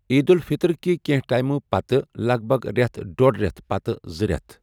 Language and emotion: Kashmiri, neutral